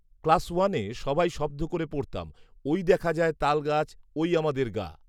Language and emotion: Bengali, neutral